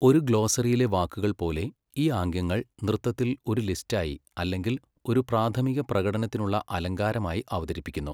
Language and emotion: Malayalam, neutral